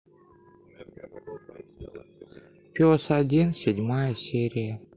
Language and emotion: Russian, sad